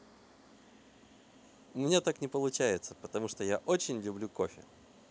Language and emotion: Russian, positive